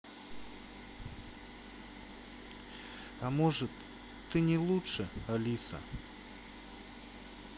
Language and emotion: Russian, sad